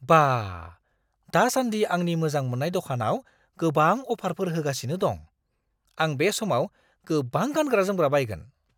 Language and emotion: Bodo, surprised